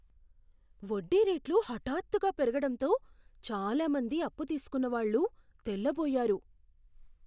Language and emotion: Telugu, surprised